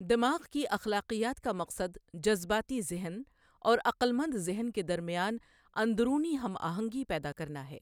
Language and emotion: Urdu, neutral